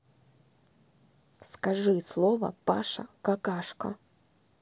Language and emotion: Russian, neutral